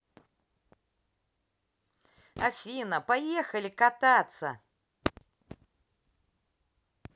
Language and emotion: Russian, positive